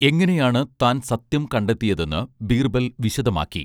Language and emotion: Malayalam, neutral